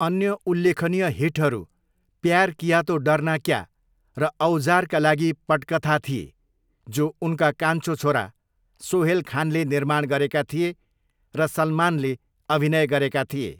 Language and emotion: Nepali, neutral